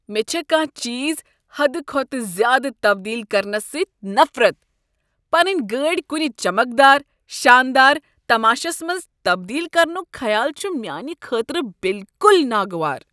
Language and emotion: Kashmiri, disgusted